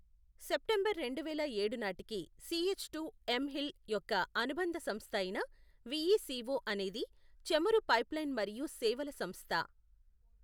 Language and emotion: Telugu, neutral